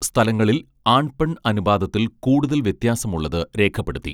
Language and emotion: Malayalam, neutral